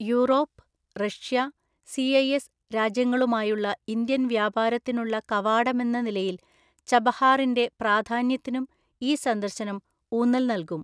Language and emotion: Malayalam, neutral